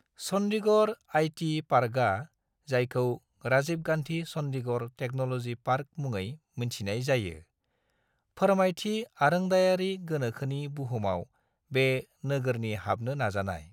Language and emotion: Bodo, neutral